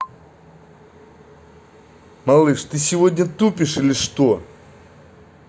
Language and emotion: Russian, angry